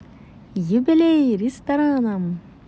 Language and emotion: Russian, positive